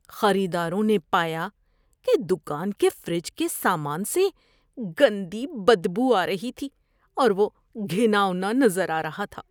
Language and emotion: Urdu, disgusted